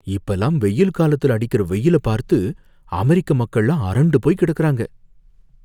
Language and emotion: Tamil, fearful